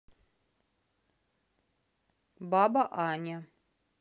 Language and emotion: Russian, neutral